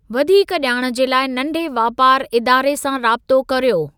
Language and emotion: Sindhi, neutral